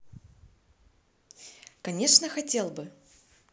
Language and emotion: Russian, positive